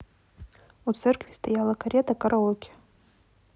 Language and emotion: Russian, neutral